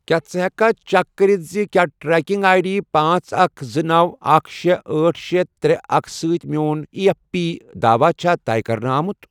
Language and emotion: Kashmiri, neutral